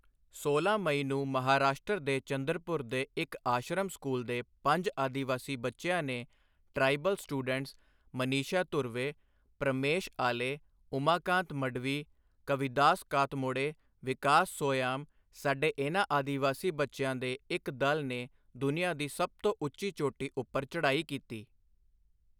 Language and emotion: Punjabi, neutral